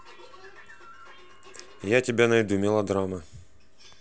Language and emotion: Russian, neutral